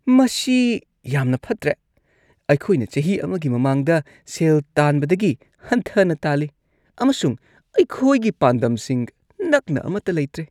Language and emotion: Manipuri, disgusted